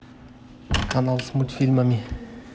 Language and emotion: Russian, neutral